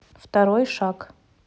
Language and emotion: Russian, neutral